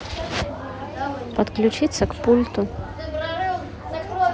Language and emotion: Russian, neutral